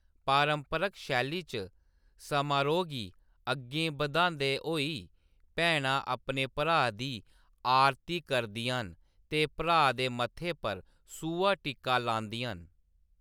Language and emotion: Dogri, neutral